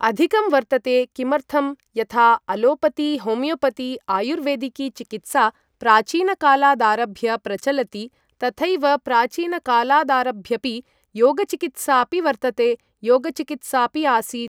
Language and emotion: Sanskrit, neutral